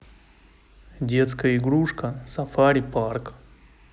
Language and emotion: Russian, neutral